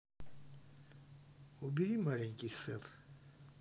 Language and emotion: Russian, neutral